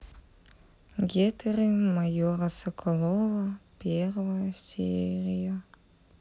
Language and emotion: Russian, sad